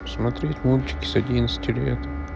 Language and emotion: Russian, sad